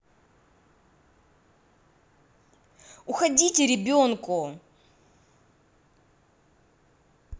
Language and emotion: Russian, angry